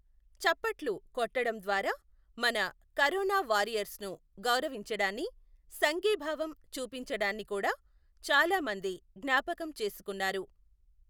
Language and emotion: Telugu, neutral